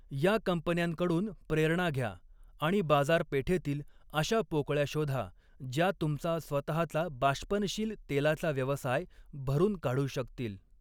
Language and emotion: Marathi, neutral